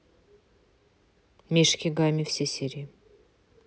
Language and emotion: Russian, neutral